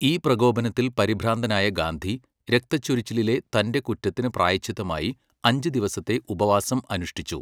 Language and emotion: Malayalam, neutral